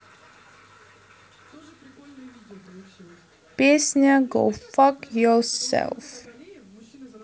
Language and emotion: Russian, neutral